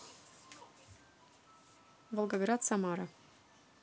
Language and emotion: Russian, neutral